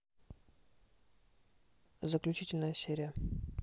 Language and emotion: Russian, neutral